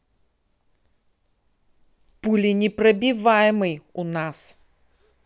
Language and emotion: Russian, angry